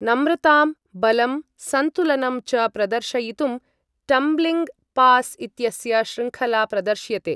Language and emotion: Sanskrit, neutral